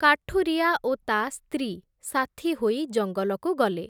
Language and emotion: Odia, neutral